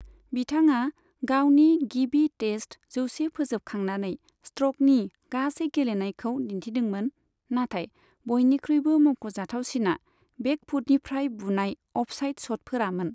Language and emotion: Bodo, neutral